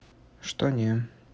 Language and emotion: Russian, neutral